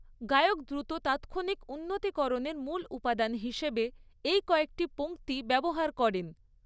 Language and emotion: Bengali, neutral